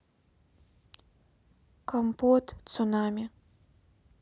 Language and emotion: Russian, neutral